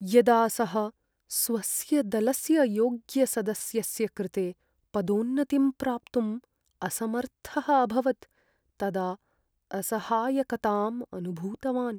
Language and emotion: Sanskrit, sad